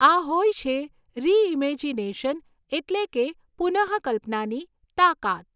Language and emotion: Gujarati, neutral